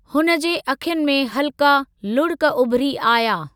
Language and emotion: Sindhi, neutral